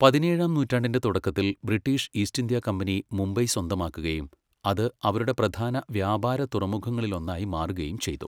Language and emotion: Malayalam, neutral